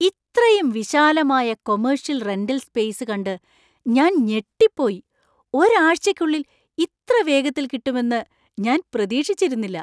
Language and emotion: Malayalam, surprised